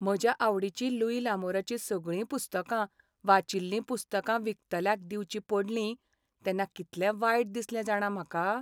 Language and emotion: Goan Konkani, sad